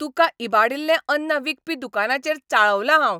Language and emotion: Goan Konkani, angry